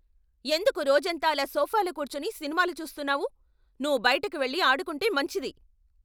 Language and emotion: Telugu, angry